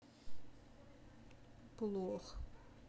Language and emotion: Russian, sad